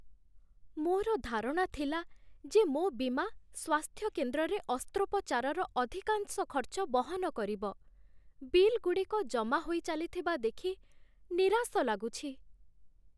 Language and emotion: Odia, sad